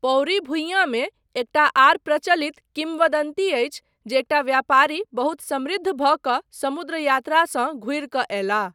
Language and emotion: Maithili, neutral